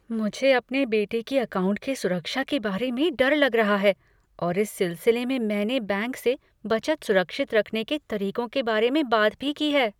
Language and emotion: Hindi, fearful